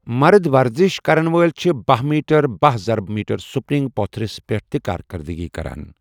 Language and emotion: Kashmiri, neutral